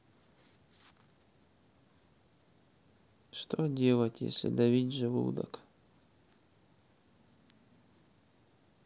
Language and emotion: Russian, sad